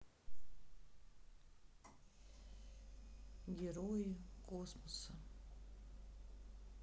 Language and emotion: Russian, neutral